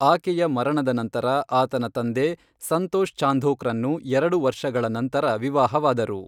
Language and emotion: Kannada, neutral